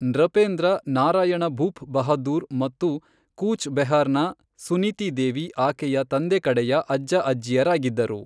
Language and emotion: Kannada, neutral